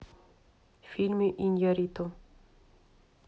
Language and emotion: Russian, neutral